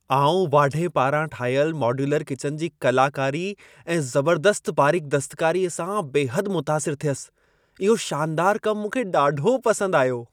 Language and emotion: Sindhi, happy